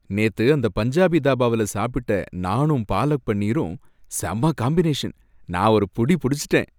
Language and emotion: Tamil, happy